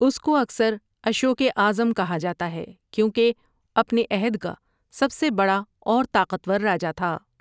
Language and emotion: Urdu, neutral